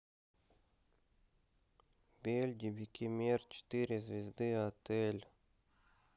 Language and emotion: Russian, neutral